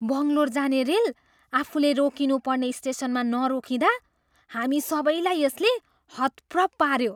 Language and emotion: Nepali, surprised